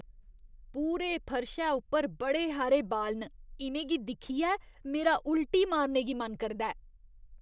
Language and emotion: Dogri, disgusted